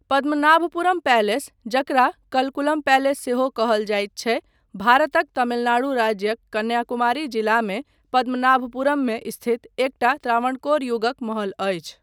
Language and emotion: Maithili, neutral